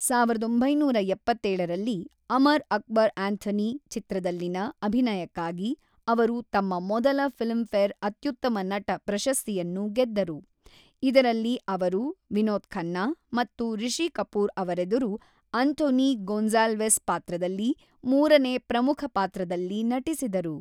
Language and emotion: Kannada, neutral